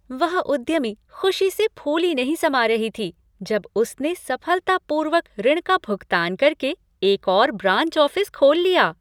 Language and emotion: Hindi, happy